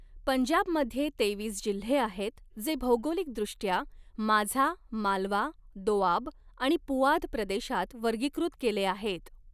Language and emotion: Marathi, neutral